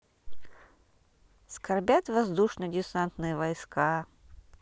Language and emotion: Russian, neutral